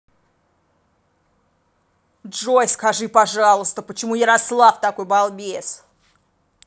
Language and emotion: Russian, angry